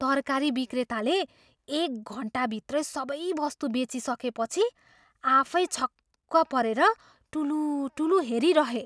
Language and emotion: Nepali, surprised